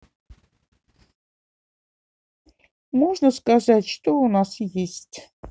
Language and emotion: Russian, neutral